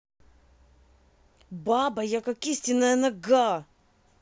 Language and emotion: Russian, angry